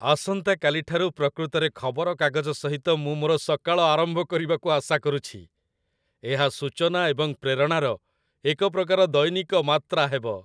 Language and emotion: Odia, happy